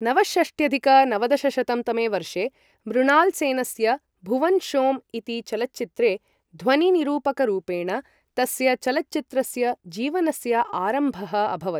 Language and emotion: Sanskrit, neutral